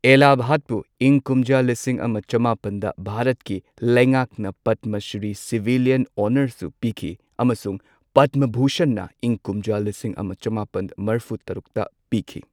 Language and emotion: Manipuri, neutral